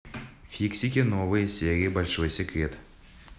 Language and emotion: Russian, neutral